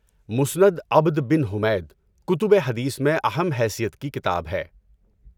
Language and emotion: Urdu, neutral